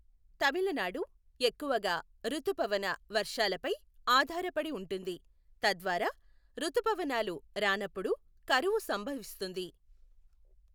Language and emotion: Telugu, neutral